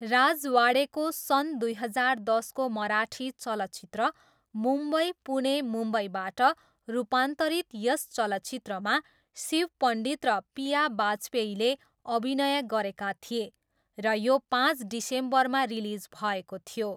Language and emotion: Nepali, neutral